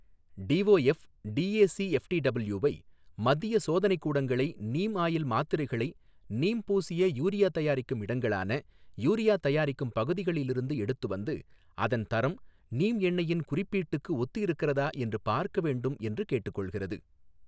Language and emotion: Tamil, neutral